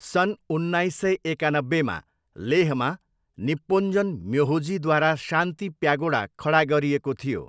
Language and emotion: Nepali, neutral